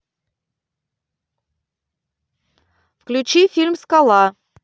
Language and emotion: Russian, neutral